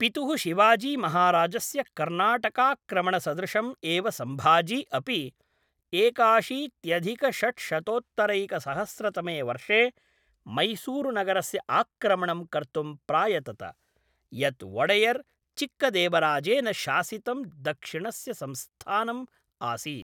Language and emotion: Sanskrit, neutral